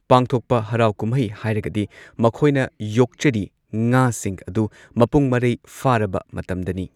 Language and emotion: Manipuri, neutral